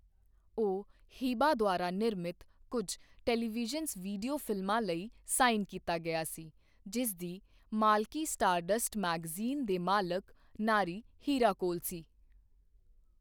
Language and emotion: Punjabi, neutral